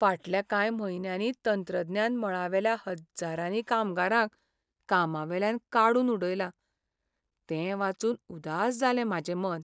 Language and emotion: Goan Konkani, sad